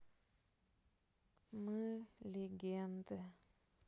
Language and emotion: Russian, sad